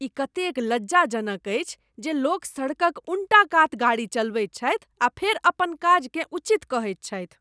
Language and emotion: Maithili, disgusted